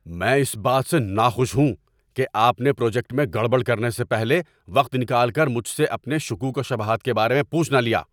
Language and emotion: Urdu, angry